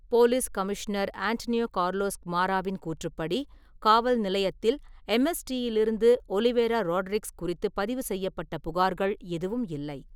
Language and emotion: Tamil, neutral